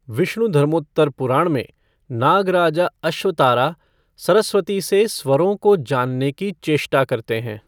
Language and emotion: Hindi, neutral